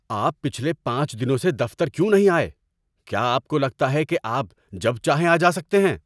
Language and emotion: Urdu, angry